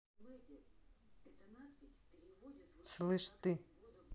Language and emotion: Russian, angry